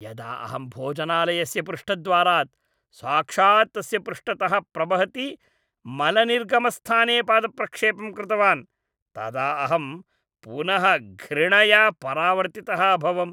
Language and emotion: Sanskrit, disgusted